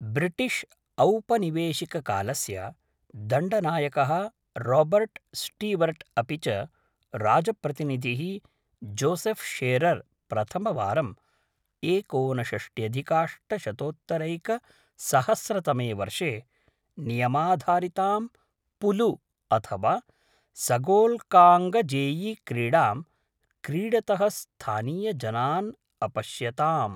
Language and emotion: Sanskrit, neutral